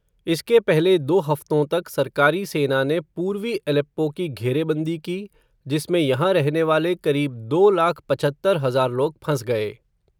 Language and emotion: Hindi, neutral